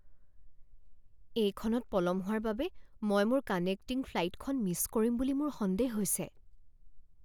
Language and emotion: Assamese, fearful